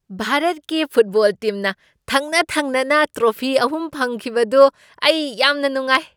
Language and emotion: Manipuri, happy